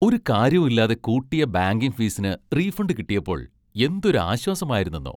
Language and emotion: Malayalam, happy